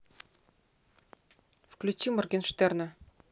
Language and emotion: Russian, neutral